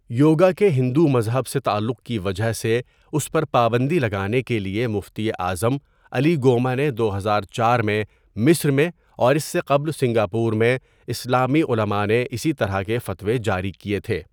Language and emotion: Urdu, neutral